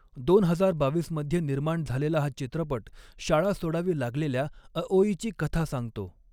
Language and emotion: Marathi, neutral